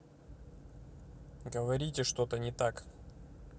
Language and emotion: Russian, neutral